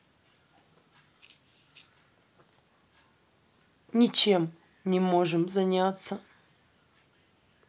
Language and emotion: Russian, sad